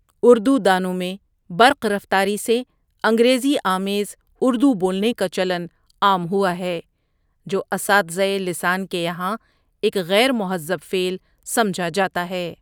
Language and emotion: Urdu, neutral